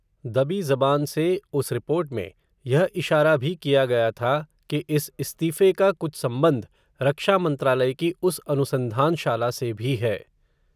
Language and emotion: Hindi, neutral